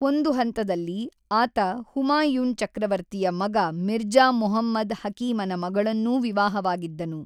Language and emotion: Kannada, neutral